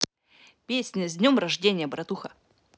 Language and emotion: Russian, positive